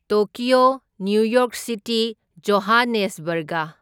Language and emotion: Manipuri, neutral